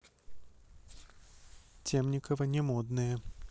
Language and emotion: Russian, neutral